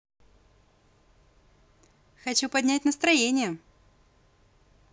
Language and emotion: Russian, positive